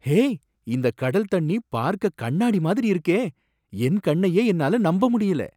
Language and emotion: Tamil, surprised